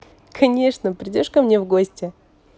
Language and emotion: Russian, positive